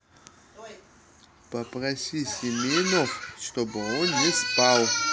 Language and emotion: Russian, neutral